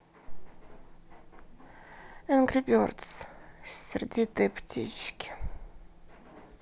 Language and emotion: Russian, sad